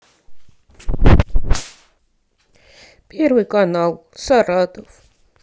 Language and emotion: Russian, sad